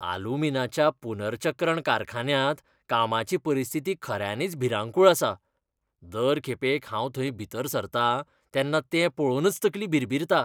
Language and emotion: Goan Konkani, disgusted